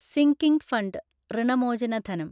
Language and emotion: Malayalam, neutral